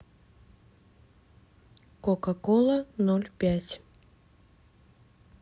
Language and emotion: Russian, neutral